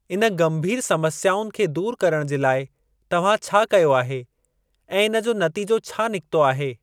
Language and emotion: Sindhi, neutral